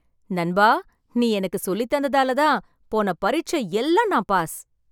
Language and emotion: Tamil, happy